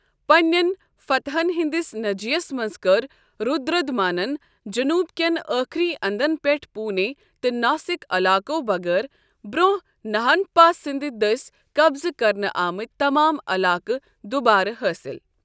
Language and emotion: Kashmiri, neutral